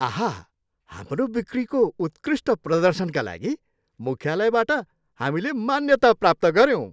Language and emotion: Nepali, happy